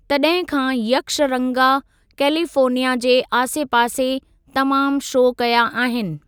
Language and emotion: Sindhi, neutral